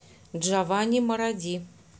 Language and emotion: Russian, neutral